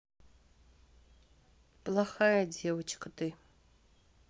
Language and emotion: Russian, sad